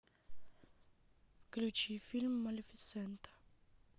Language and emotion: Russian, neutral